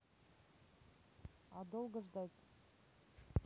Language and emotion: Russian, neutral